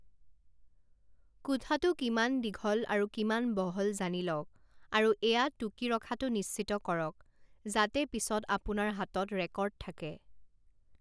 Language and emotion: Assamese, neutral